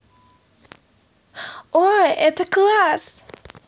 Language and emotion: Russian, positive